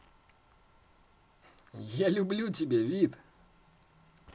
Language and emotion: Russian, positive